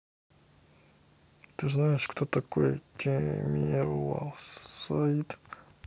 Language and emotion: Russian, neutral